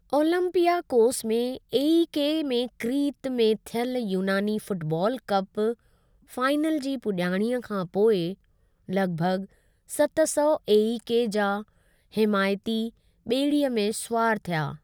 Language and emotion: Sindhi, neutral